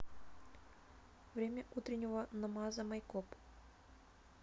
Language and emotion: Russian, neutral